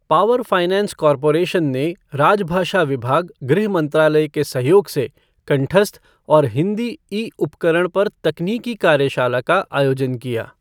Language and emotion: Hindi, neutral